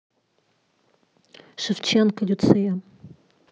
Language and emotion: Russian, neutral